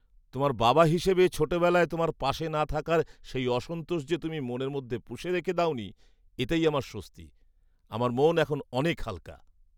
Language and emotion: Bengali, happy